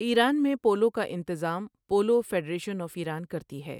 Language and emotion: Urdu, neutral